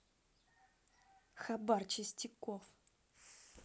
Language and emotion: Russian, angry